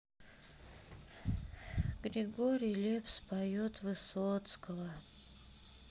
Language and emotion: Russian, sad